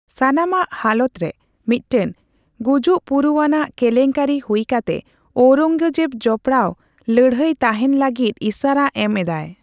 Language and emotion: Santali, neutral